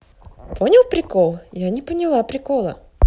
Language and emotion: Russian, positive